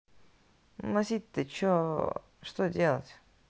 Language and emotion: Russian, neutral